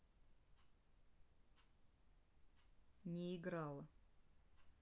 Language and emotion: Russian, neutral